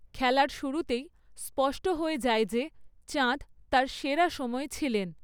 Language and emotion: Bengali, neutral